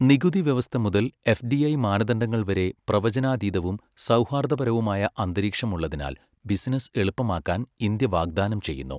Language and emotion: Malayalam, neutral